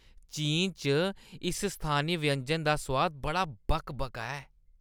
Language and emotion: Dogri, disgusted